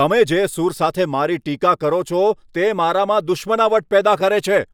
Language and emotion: Gujarati, angry